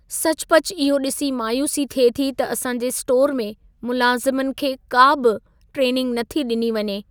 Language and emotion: Sindhi, sad